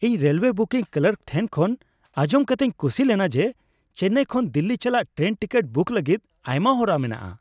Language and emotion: Santali, happy